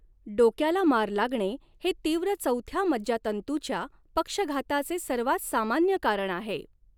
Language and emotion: Marathi, neutral